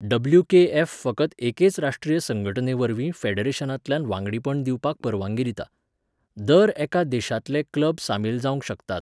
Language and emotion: Goan Konkani, neutral